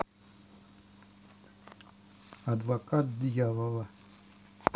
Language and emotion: Russian, neutral